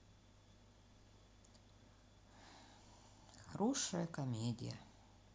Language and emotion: Russian, neutral